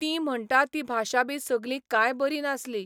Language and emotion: Goan Konkani, neutral